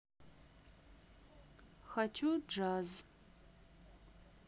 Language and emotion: Russian, sad